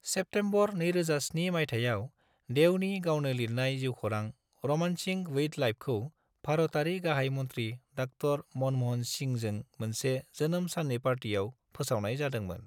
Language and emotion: Bodo, neutral